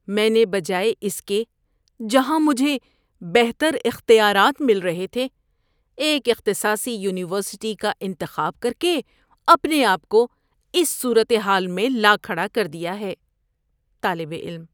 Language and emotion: Urdu, disgusted